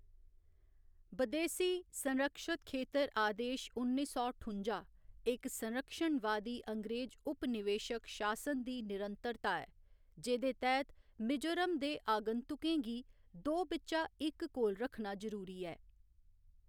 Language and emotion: Dogri, neutral